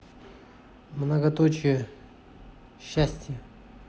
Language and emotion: Russian, neutral